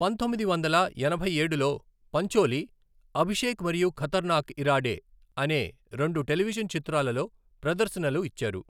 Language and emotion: Telugu, neutral